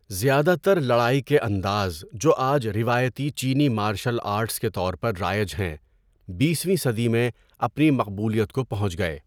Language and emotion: Urdu, neutral